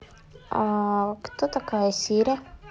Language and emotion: Russian, neutral